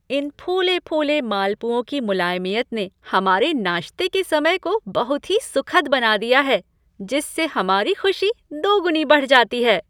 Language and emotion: Hindi, happy